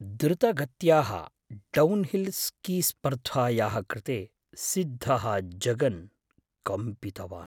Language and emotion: Sanskrit, fearful